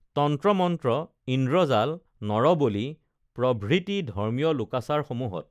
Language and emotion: Assamese, neutral